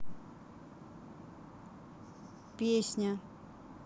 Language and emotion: Russian, neutral